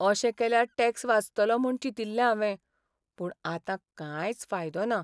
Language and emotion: Goan Konkani, sad